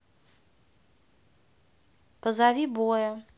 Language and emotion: Russian, neutral